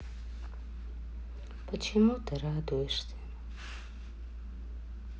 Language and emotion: Russian, sad